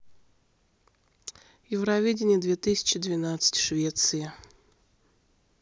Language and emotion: Russian, neutral